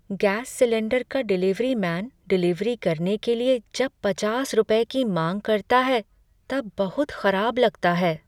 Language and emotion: Hindi, sad